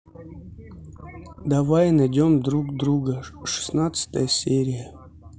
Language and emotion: Russian, neutral